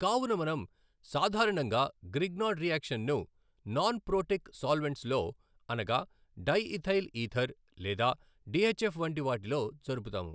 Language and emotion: Telugu, neutral